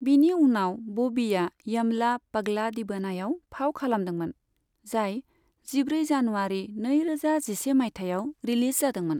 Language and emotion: Bodo, neutral